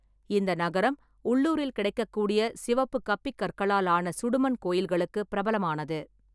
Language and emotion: Tamil, neutral